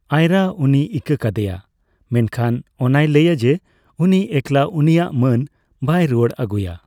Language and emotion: Santali, neutral